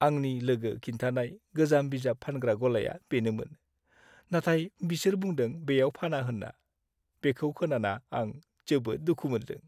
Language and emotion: Bodo, sad